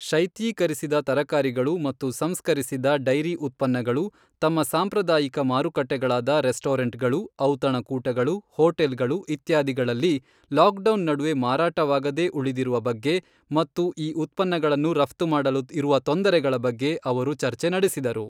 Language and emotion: Kannada, neutral